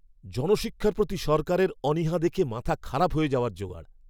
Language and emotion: Bengali, angry